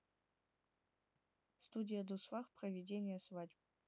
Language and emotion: Russian, neutral